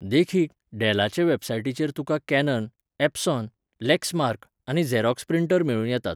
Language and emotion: Goan Konkani, neutral